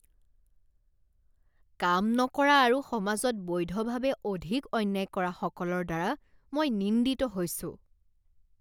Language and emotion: Assamese, disgusted